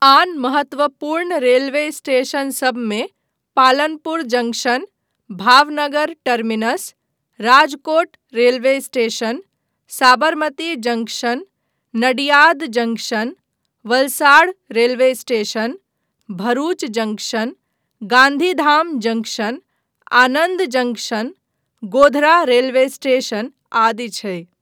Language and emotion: Maithili, neutral